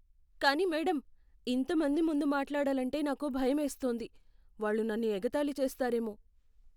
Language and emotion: Telugu, fearful